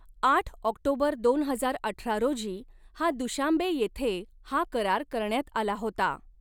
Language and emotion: Marathi, neutral